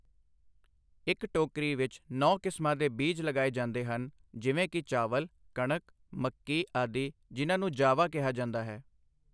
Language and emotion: Punjabi, neutral